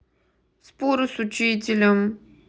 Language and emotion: Russian, neutral